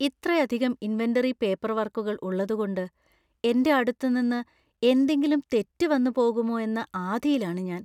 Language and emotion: Malayalam, fearful